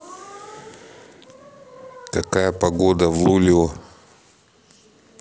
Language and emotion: Russian, neutral